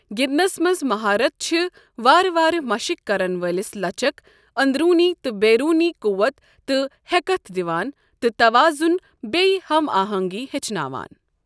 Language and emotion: Kashmiri, neutral